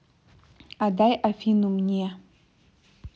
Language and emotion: Russian, neutral